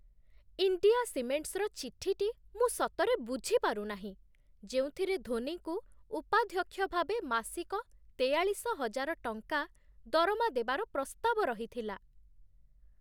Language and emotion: Odia, surprised